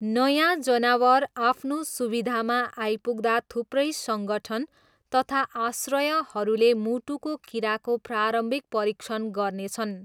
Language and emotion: Nepali, neutral